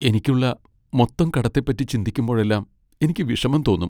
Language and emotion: Malayalam, sad